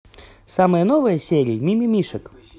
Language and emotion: Russian, positive